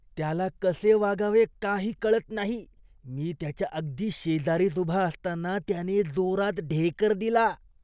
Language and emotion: Marathi, disgusted